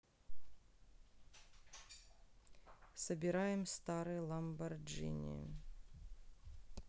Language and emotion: Russian, neutral